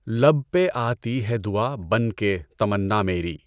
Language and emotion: Urdu, neutral